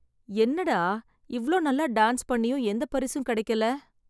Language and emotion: Tamil, sad